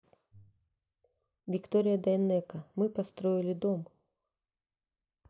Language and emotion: Russian, neutral